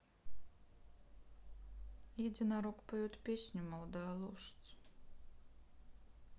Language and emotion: Russian, sad